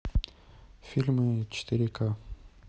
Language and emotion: Russian, neutral